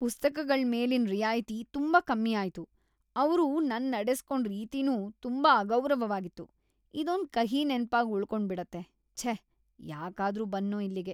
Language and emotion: Kannada, disgusted